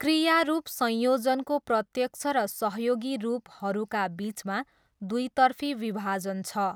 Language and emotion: Nepali, neutral